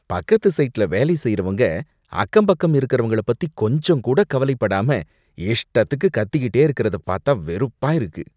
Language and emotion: Tamil, disgusted